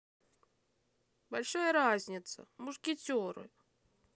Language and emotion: Russian, angry